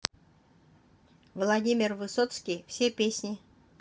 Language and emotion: Russian, neutral